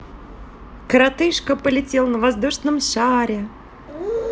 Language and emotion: Russian, positive